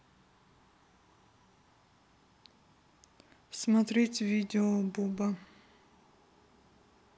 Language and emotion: Russian, neutral